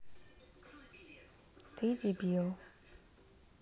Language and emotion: Russian, neutral